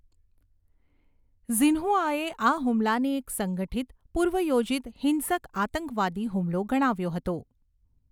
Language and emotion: Gujarati, neutral